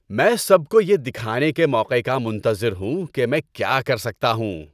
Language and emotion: Urdu, happy